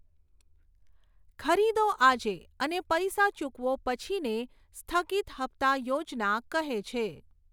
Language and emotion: Gujarati, neutral